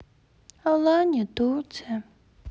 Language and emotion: Russian, sad